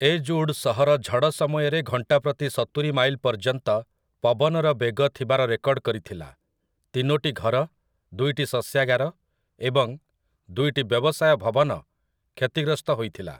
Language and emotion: Odia, neutral